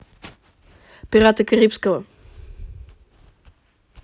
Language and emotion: Russian, neutral